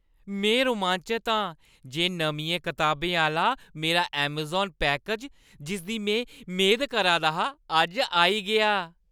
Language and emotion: Dogri, happy